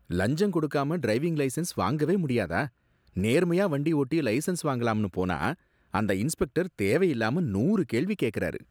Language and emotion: Tamil, disgusted